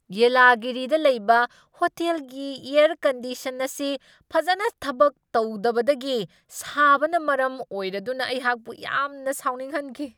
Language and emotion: Manipuri, angry